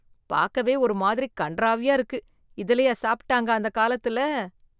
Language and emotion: Tamil, disgusted